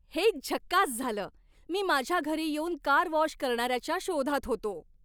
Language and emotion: Marathi, happy